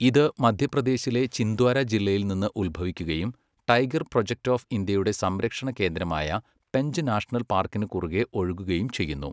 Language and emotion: Malayalam, neutral